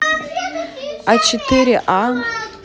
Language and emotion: Russian, neutral